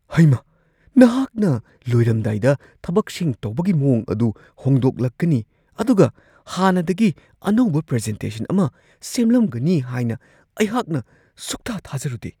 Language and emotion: Manipuri, surprised